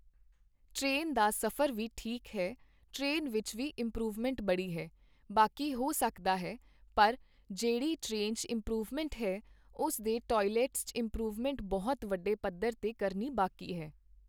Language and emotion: Punjabi, neutral